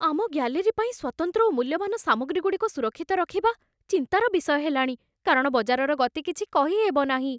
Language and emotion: Odia, fearful